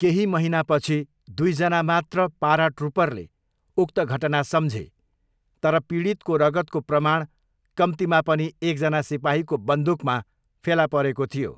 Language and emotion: Nepali, neutral